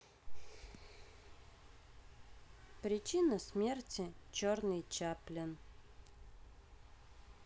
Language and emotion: Russian, neutral